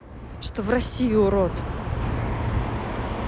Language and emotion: Russian, angry